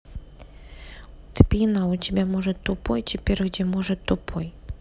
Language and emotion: Russian, neutral